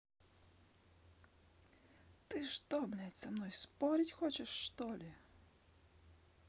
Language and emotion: Russian, angry